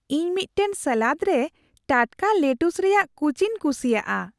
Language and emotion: Santali, happy